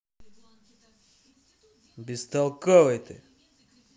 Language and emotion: Russian, angry